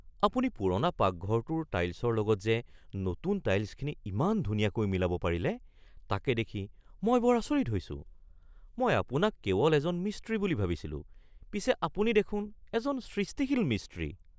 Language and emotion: Assamese, surprised